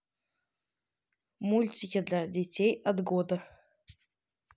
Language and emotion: Russian, neutral